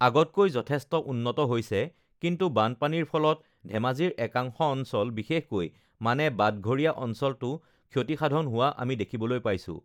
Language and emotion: Assamese, neutral